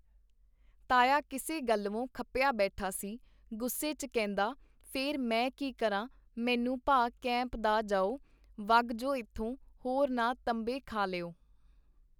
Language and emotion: Punjabi, neutral